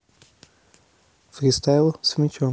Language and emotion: Russian, neutral